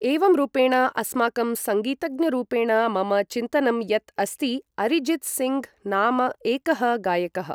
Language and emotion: Sanskrit, neutral